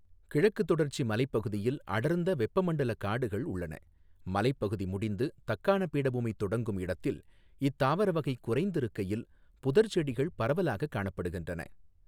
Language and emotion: Tamil, neutral